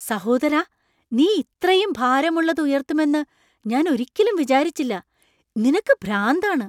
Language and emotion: Malayalam, surprised